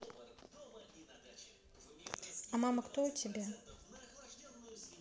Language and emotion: Russian, neutral